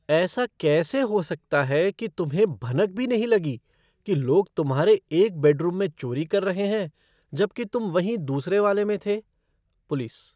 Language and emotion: Hindi, surprised